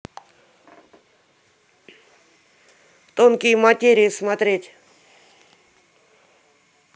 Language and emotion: Russian, neutral